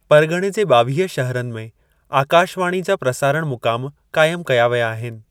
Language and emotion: Sindhi, neutral